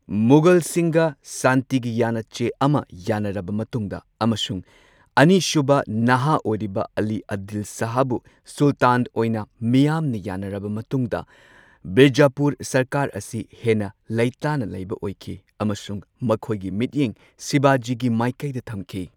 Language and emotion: Manipuri, neutral